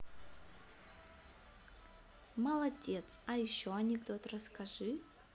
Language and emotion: Russian, positive